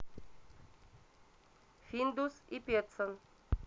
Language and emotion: Russian, neutral